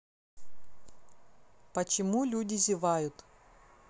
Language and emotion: Russian, neutral